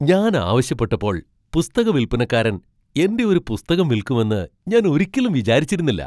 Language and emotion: Malayalam, surprised